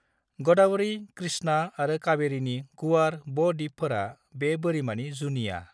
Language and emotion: Bodo, neutral